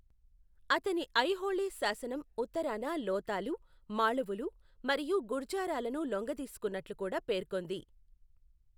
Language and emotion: Telugu, neutral